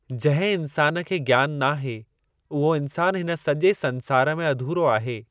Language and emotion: Sindhi, neutral